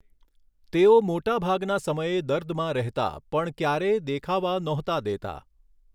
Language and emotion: Gujarati, neutral